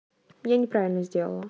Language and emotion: Russian, neutral